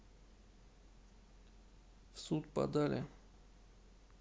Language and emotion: Russian, neutral